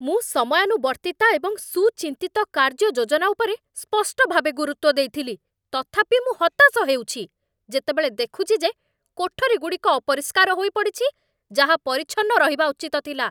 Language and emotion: Odia, angry